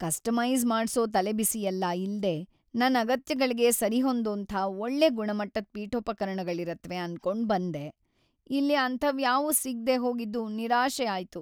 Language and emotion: Kannada, sad